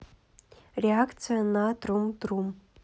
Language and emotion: Russian, neutral